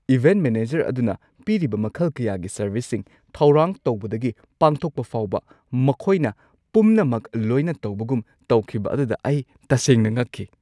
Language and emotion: Manipuri, surprised